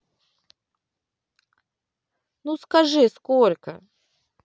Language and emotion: Russian, angry